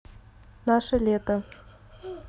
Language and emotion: Russian, neutral